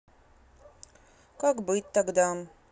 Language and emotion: Russian, sad